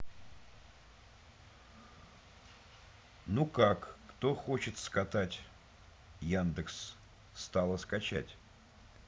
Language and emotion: Russian, neutral